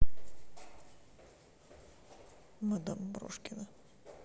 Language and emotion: Russian, sad